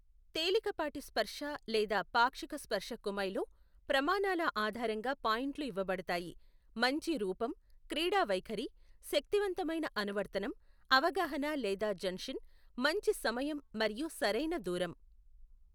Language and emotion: Telugu, neutral